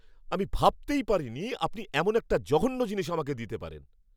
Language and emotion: Bengali, angry